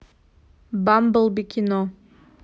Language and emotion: Russian, neutral